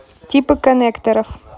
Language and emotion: Russian, neutral